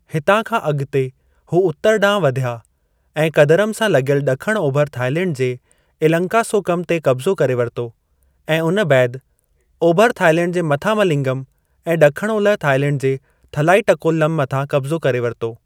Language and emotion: Sindhi, neutral